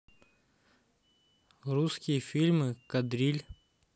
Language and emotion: Russian, neutral